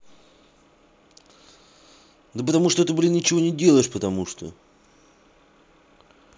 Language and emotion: Russian, angry